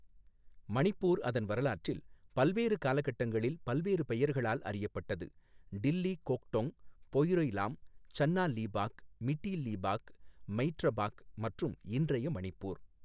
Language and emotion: Tamil, neutral